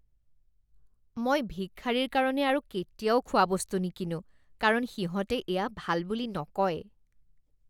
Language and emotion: Assamese, disgusted